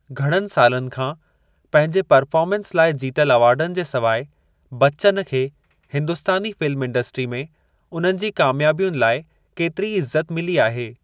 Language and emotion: Sindhi, neutral